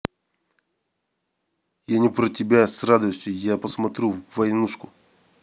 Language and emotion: Russian, angry